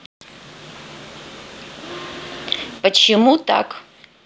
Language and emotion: Russian, neutral